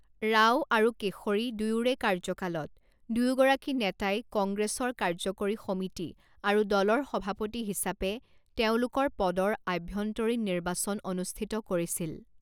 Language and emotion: Assamese, neutral